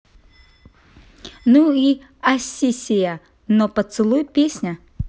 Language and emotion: Russian, positive